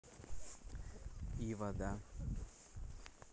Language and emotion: Russian, neutral